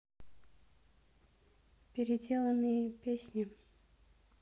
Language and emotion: Russian, neutral